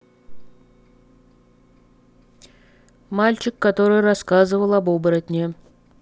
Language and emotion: Russian, neutral